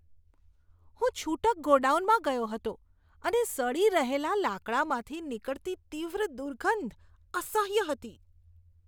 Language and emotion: Gujarati, disgusted